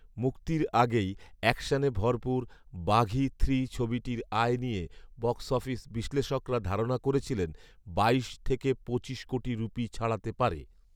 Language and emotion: Bengali, neutral